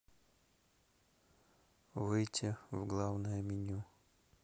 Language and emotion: Russian, neutral